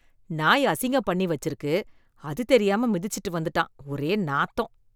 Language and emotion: Tamil, disgusted